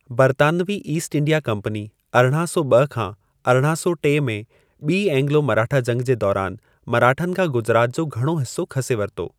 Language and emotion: Sindhi, neutral